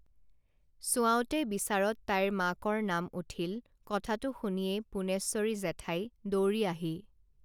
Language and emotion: Assamese, neutral